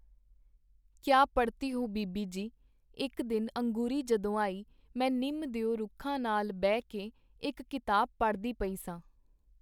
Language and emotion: Punjabi, neutral